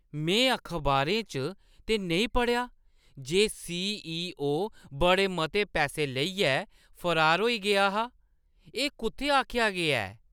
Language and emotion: Dogri, surprised